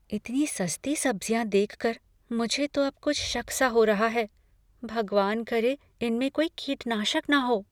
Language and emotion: Hindi, fearful